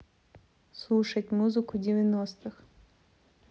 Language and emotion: Russian, neutral